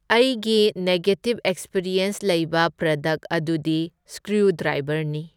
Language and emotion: Manipuri, neutral